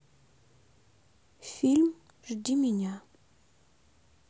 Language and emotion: Russian, sad